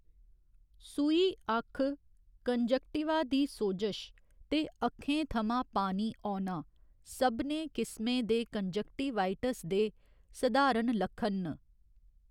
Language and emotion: Dogri, neutral